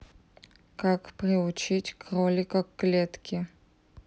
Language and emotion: Russian, neutral